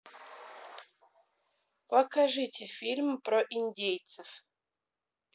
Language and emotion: Russian, neutral